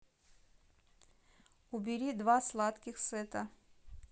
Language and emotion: Russian, neutral